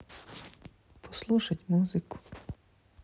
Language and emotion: Russian, sad